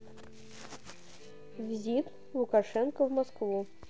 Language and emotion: Russian, neutral